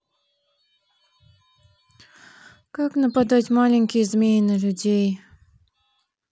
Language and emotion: Russian, sad